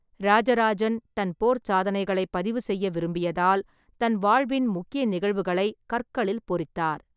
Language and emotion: Tamil, neutral